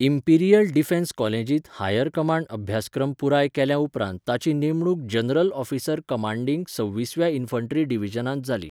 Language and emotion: Goan Konkani, neutral